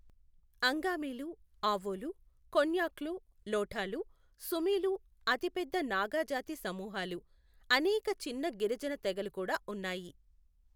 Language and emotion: Telugu, neutral